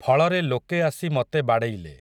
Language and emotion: Odia, neutral